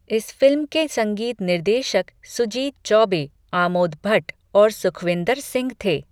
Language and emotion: Hindi, neutral